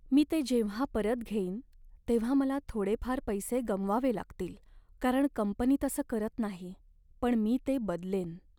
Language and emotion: Marathi, sad